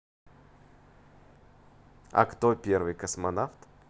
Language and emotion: Russian, positive